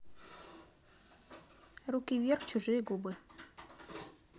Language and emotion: Russian, neutral